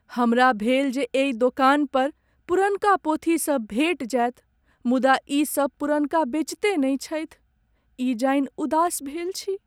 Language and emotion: Maithili, sad